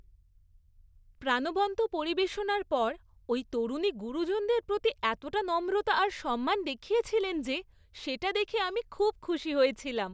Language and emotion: Bengali, happy